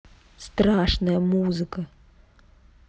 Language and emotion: Russian, neutral